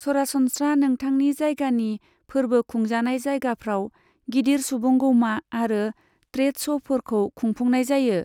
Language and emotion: Bodo, neutral